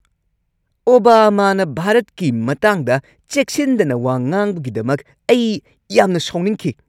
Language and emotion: Manipuri, angry